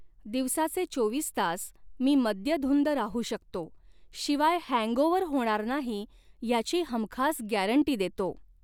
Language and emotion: Marathi, neutral